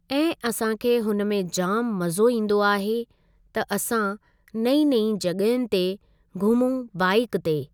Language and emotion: Sindhi, neutral